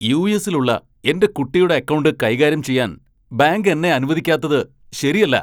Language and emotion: Malayalam, angry